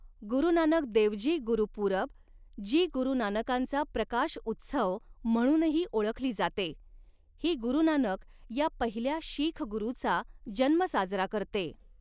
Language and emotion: Marathi, neutral